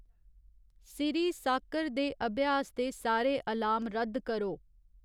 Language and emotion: Dogri, neutral